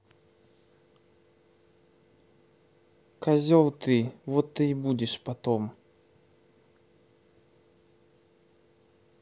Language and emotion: Russian, angry